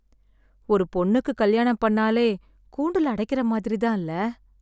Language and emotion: Tamil, sad